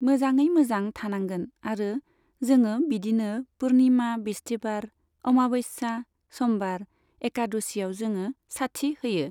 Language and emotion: Bodo, neutral